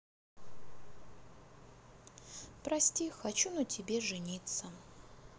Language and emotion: Russian, sad